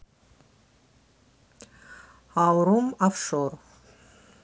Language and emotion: Russian, neutral